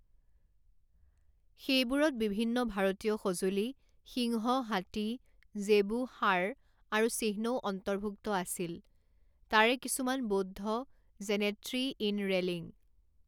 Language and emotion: Assamese, neutral